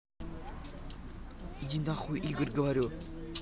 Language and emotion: Russian, angry